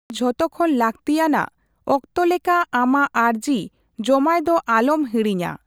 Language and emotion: Santali, neutral